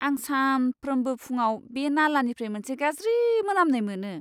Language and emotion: Bodo, disgusted